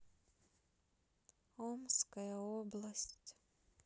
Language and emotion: Russian, sad